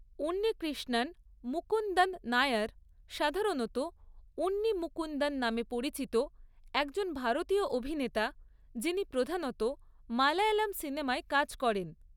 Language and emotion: Bengali, neutral